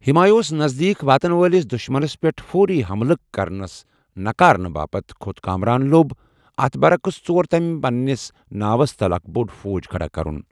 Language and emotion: Kashmiri, neutral